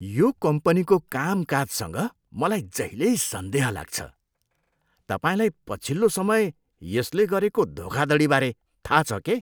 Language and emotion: Nepali, disgusted